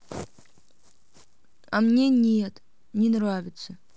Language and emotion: Russian, sad